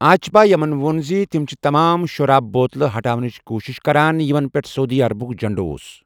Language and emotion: Kashmiri, neutral